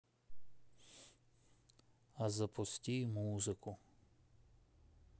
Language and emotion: Russian, sad